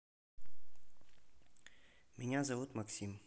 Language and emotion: Russian, neutral